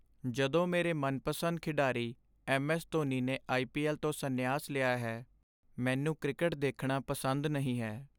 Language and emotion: Punjabi, sad